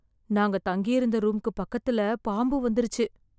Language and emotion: Tamil, fearful